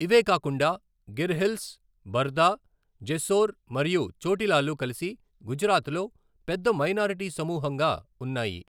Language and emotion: Telugu, neutral